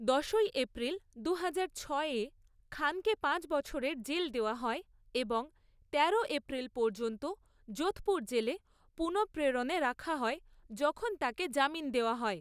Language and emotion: Bengali, neutral